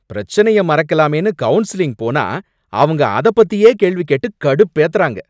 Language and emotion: Tamil, angry